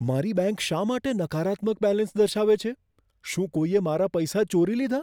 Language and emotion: Gujarati, fearful